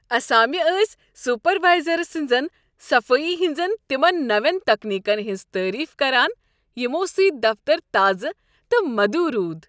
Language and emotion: Kashmiri, happy